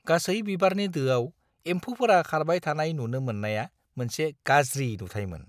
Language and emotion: Bodo, disgusted